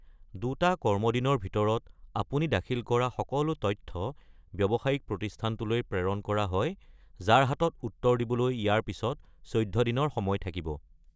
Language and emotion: Assamese, neutral